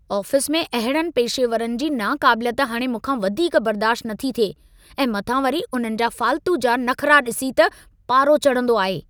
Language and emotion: Sindhi, angry